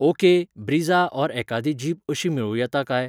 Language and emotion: Goan Konkani, neutral